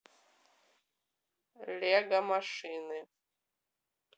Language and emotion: Russian, neutral